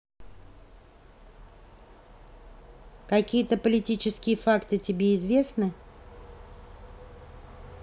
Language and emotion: Russian, neutral